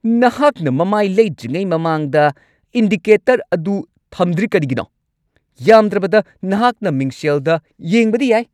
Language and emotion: Manipuri, angry